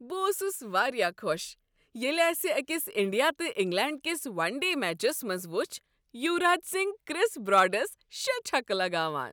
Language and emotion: Kashmiri, happy